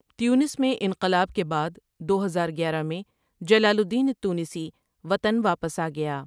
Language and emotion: Urdu, neutral